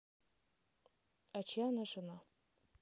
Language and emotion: Russian, neutral